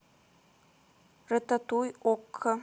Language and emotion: Russian, neutral